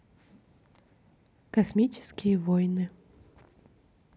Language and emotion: Russian, neutral